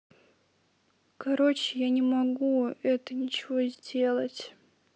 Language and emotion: Russian, sad